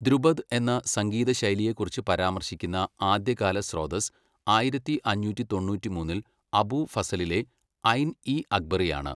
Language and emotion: Malayalam, neutral